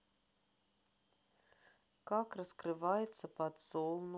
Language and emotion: Russian, neutral